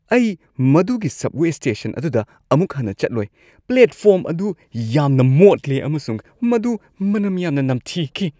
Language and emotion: Manipuri, disgusted